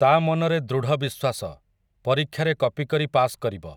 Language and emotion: Odia, neutral